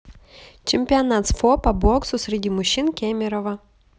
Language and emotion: Russian, neutral